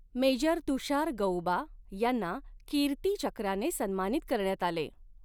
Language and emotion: Marathi, neutral